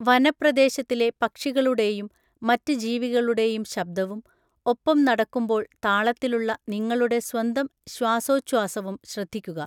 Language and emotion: Malayalam, neutral